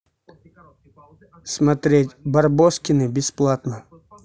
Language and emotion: Russian, neutral